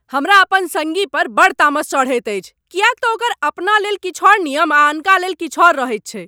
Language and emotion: Maithili, angry